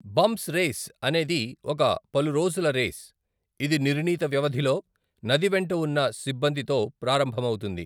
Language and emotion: Telugu, neutral